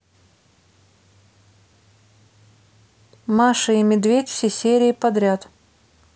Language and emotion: Russian, neutral